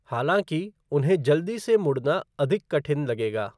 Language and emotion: Hindi, neutral